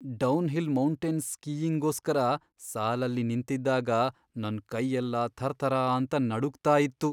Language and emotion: Kannada, fearful